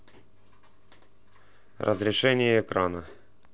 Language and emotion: Russian, neutral